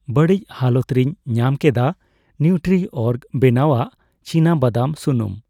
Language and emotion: Santali, neutral